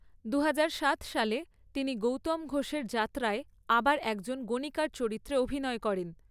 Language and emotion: Bengali, neutral